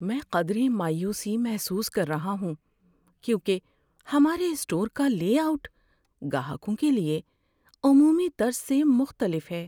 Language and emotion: Urdu, sad